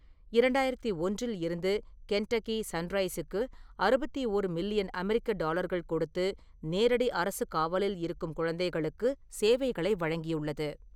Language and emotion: Tamil, neutral